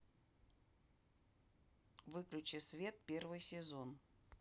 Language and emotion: Russian, neutral